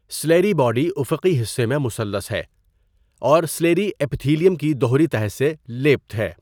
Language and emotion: Urdu, neutral